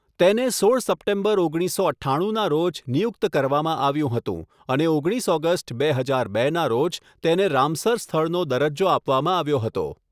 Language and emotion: Gujarati, neutral